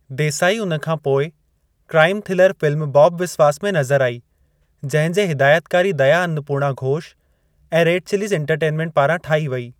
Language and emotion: Sindhi, neutral